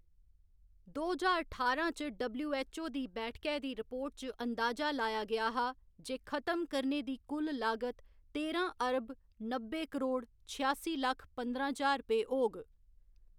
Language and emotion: Dogri, neutral